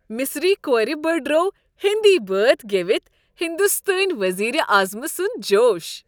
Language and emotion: Kashmiri, happy